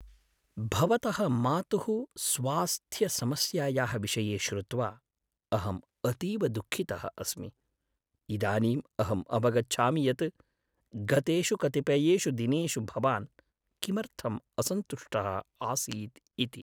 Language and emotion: Sanskrit, sad